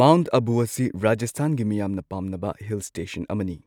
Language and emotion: Manipuri, neutral